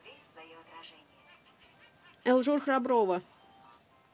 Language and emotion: Russian, neutral